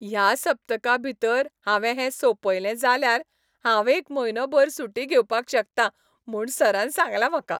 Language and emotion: Goan Konkani, happy